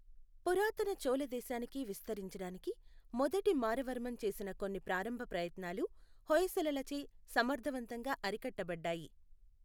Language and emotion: Telugu, neutral